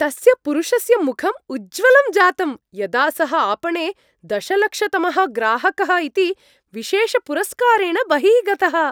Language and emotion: Sanskrit, happy